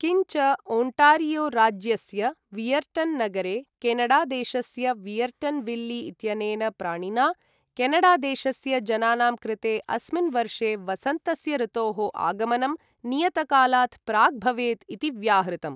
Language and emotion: Sanskrit, neutral